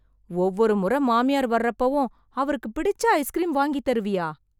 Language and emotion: Tamil, surprised